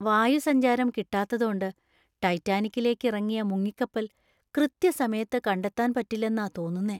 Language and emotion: Malayalam, fearful